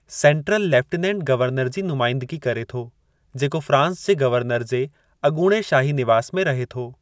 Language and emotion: Sindhi, neutral